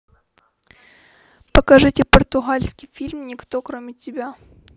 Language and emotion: Russian, neutral